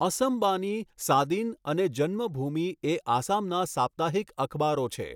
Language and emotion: Gujarati, neutral